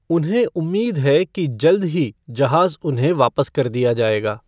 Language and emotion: Hindi, neutral